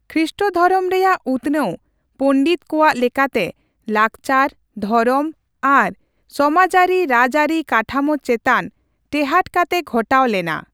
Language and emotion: Santali, neutral